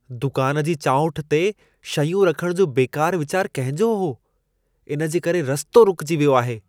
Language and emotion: Sindhi, disgusted